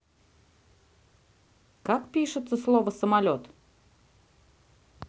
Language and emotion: Russian, neutral